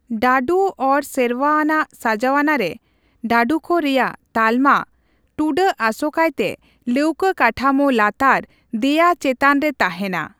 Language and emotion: Santali, neutral